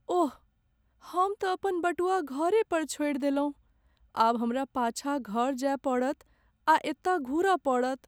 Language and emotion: Maithili, sad